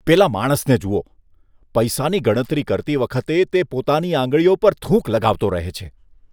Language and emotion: Gujarati, disgusted